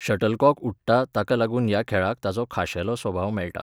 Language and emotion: Goan Konkani, neutral